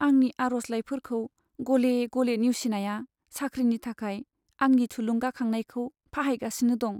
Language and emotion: Bodo, sad